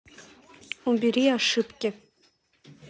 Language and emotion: Russian, neutral